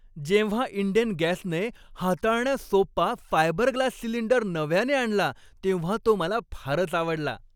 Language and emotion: Marathi, happy